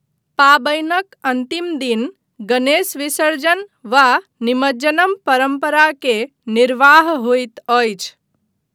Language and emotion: Maithili, neutral